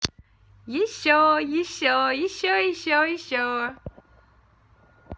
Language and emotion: Russian, positive